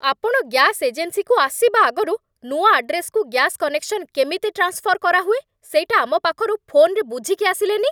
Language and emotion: Odia, angry